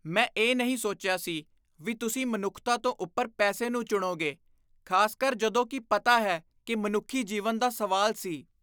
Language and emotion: Punjabi, disgusted